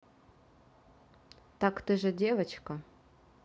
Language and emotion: Russian, neutral